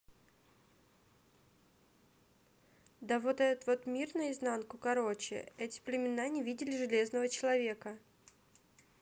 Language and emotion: Russian, neutral